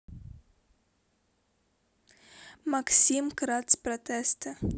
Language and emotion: Russian, neutral